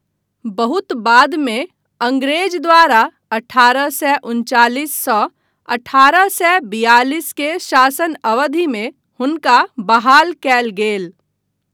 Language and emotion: Maithili, neutral